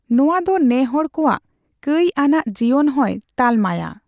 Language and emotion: Santali, neutral